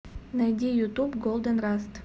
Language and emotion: Russian, neutral